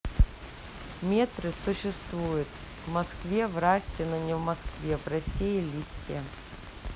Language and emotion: Russian, neutral